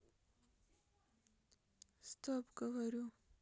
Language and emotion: Russian, sad